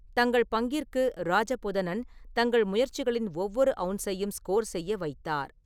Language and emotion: Tamil, neutral